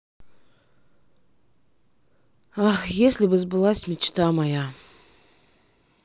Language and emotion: Russian, sad